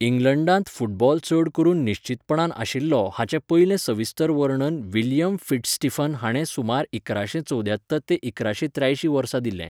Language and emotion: Goan Konkani, neutral